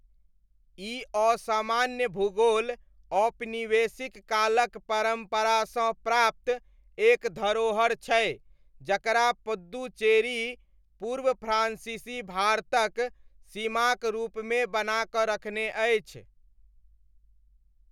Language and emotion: Maithili, neutral